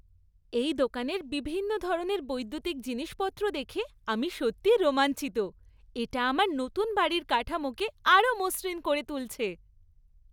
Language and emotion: Bengali, happy